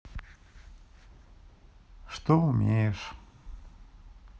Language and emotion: Russian, neutral